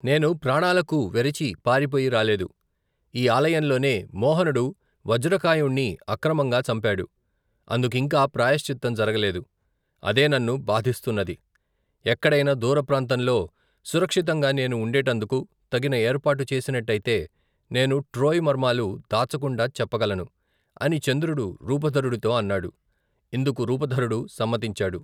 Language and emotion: Telugu, neutral